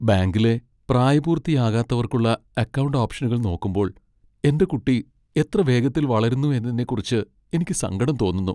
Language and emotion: Malayalam, sad